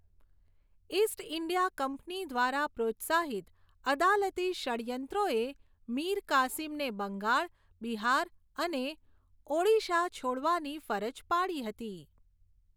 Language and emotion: Gujarati, neutral